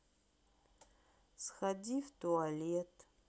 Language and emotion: Russian, neutral